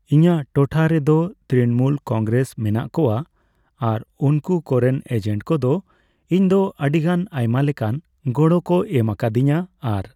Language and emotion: Santali, neutral